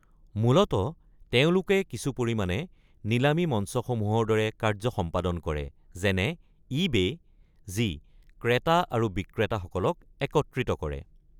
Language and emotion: Assamese, neutral